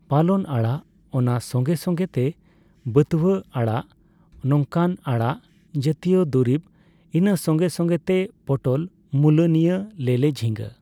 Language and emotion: Santali, neutral